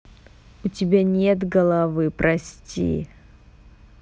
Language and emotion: Russian, neutral